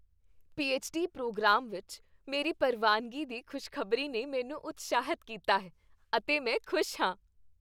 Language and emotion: Punjabi, happy